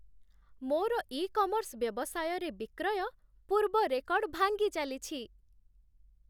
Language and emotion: Odia, happy